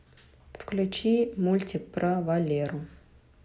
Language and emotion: Russian, neutral